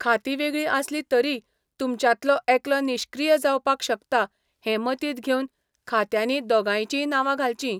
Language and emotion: Goan Konkani, neutral